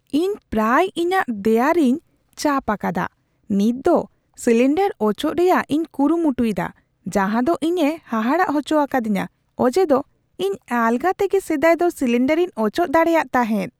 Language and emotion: Santali, surprised